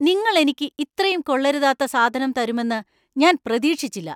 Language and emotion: Malayalam, angry